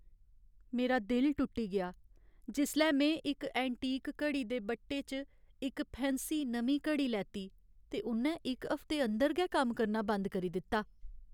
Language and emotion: Dogri, sad